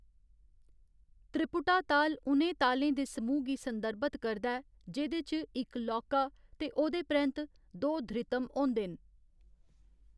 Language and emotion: Dogri, neutral